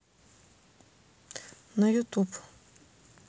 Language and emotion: Russian, neutral